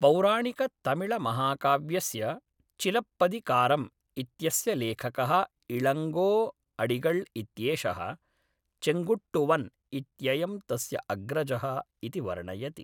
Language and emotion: Sanskrit, neutral